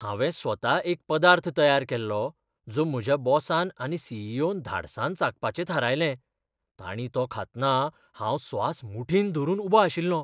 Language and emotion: Goan Konkani, fearful